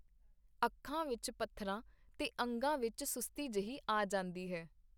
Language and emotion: Punjabi, neutral